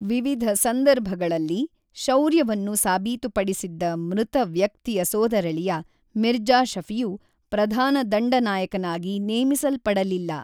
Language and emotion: Kannada, neutral